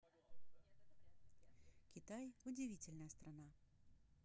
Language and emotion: Russian, neutral